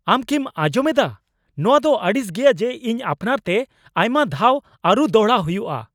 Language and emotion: Santali, angry